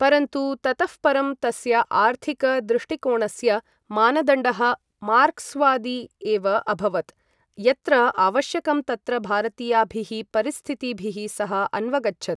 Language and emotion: Sanskrit, neutral